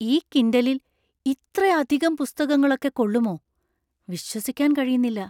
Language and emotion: Malayalam, surprised